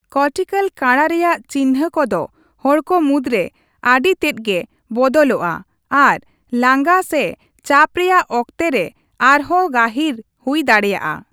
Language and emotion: Santali, neutral